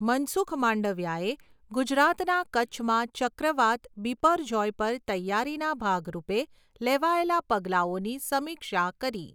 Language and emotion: Gujarati, neutral